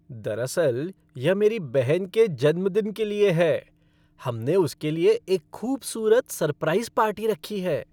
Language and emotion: Hindi, happy